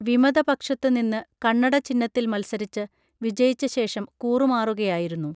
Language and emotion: Malayalam, neutral